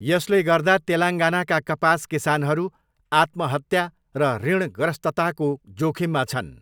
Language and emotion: Nepali, neutral